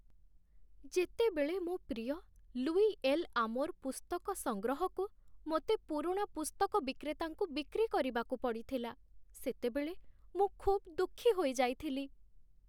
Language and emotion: Odia, sad